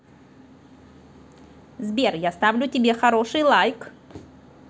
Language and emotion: Russian, positive